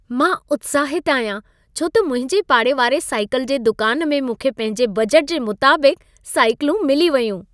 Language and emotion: Sindhi, happy